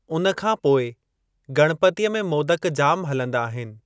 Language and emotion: Sindhi, neutral